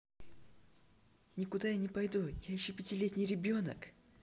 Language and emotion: Russian, neutral